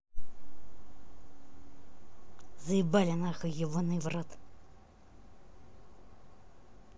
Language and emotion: Russian, angry